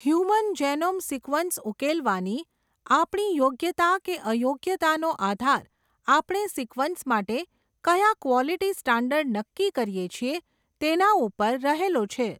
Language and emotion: Gujarati, neutral